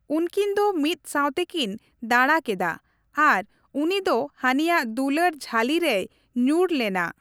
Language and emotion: Santali, neutral